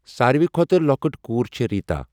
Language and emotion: Kashmiri, neutral